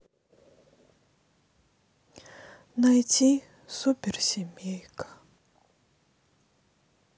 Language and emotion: Russian, sad